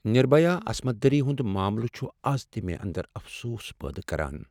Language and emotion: Kashmiri, sad